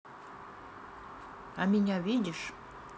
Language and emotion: Russian, neutral